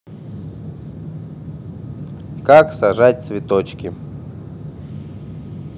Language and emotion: Russian, neutral